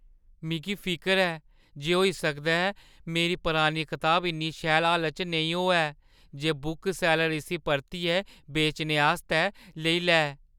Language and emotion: Dogri, fearful